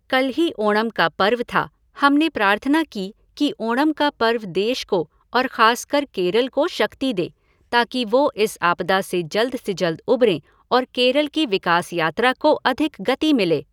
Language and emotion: Hindi, neutral